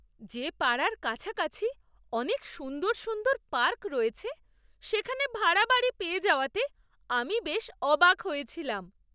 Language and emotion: Bengali, surprised